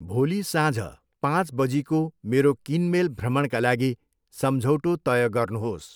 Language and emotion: Nepali, neutral